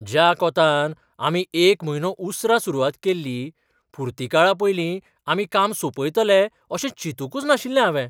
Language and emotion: Goan Konkani, surprised